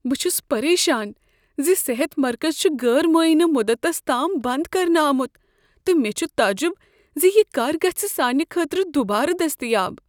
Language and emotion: Kashmiri, fearful